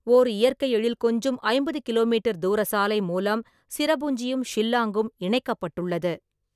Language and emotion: Tamil, neutral